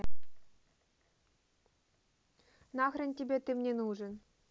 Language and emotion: Russian, neutral